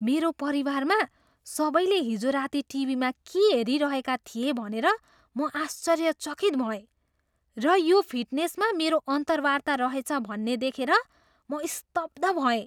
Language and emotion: Nepali, surprised